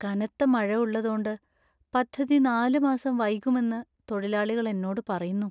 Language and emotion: Malayalam, sad